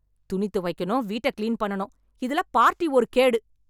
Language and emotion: Tamil, angry